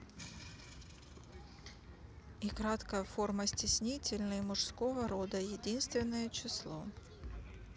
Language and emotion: Russian, neutral